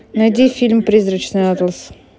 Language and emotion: Russian, neutral